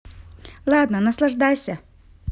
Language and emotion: Russian, positive